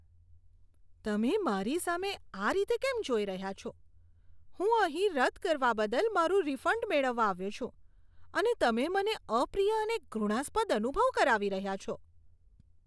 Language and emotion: Gujarati, disgusted